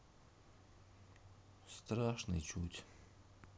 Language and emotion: Russian, sad